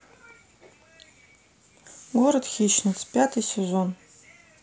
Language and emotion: Russian, neutral